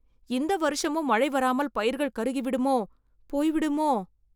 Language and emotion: Tamil, fearful